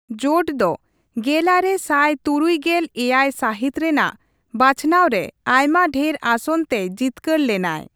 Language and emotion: Santali, neutral